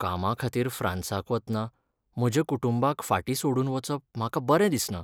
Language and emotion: Goan Konkani, sad